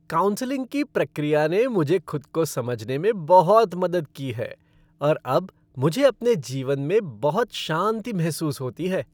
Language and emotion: Hindi, happy